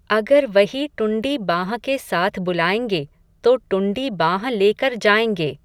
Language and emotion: Hindi, neutral